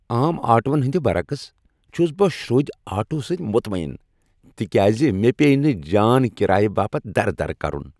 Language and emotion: Kashmiri, happy